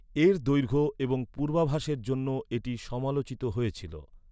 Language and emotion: Bengali, neutral